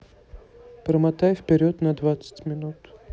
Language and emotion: Russian, neutral